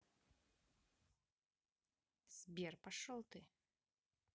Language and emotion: Russian, angry